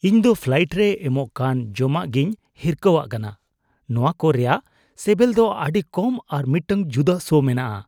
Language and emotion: Santali, disgusted